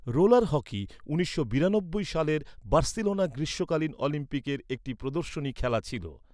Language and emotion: Bengali, neutral